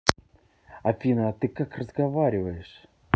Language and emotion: Russian, angry